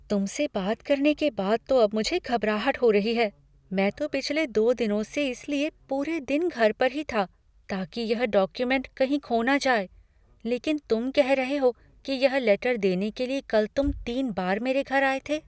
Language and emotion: Hindi, fearful